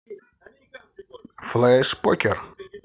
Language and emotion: Russian, positive